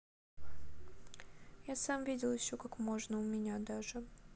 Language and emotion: Russian, sad